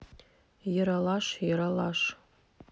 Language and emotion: Russian, neutral